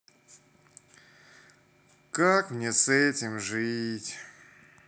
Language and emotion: Russian, sad